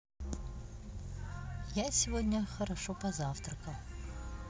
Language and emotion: Russian, neutral